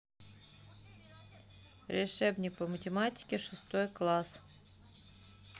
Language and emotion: Russian, neutral